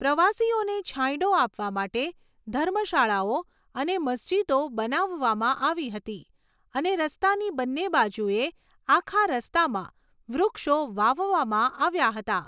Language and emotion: Gujarati, neutral